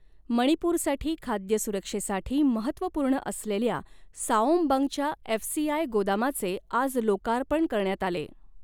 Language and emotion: Marathi, neutral